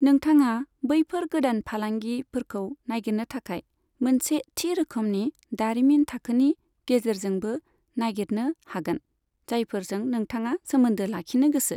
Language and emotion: Bodo, neutral